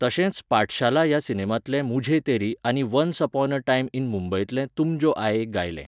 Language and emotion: Goan Konkani, neutral